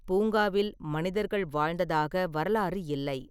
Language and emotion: Tamil, neutral